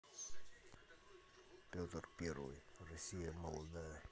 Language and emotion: Russian, neutral